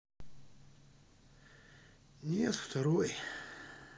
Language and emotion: Russian, sad